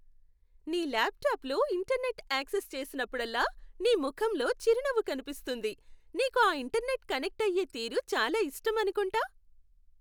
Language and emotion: Telugu, happy